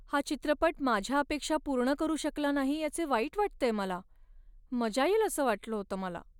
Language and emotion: Marathi, sad